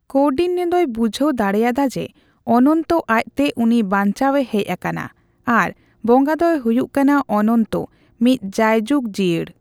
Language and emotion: Santali, neutral